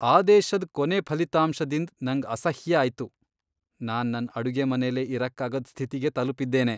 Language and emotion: Kannada, disgusted